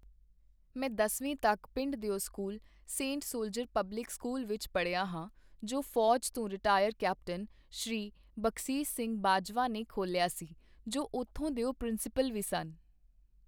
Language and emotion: Punjabi, neutral